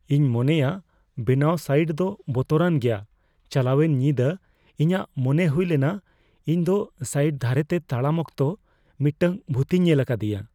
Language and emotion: Santali, fearful